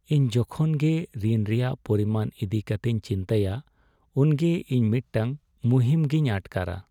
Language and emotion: Santali, sad